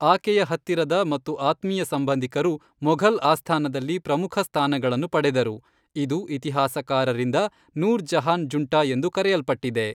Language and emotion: Kannada, neutral